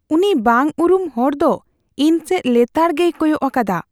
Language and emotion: Santali, fearful